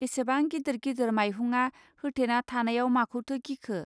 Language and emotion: Bodo, neutral